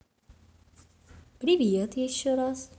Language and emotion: Russian, positive